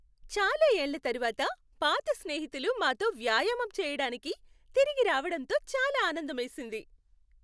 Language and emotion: Telugu, happy